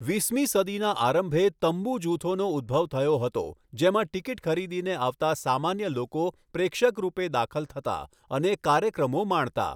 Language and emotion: Gujarati, neutral